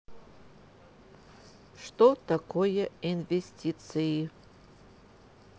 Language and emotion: Russian, neutral